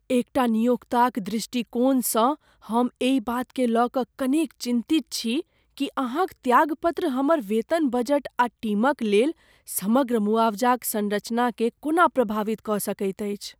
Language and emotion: Maithili, fearful